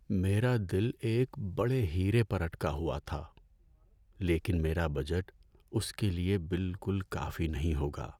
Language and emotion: Urdu, sad